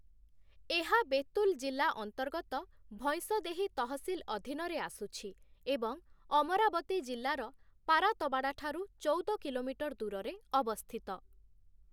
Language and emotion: Odia, neutral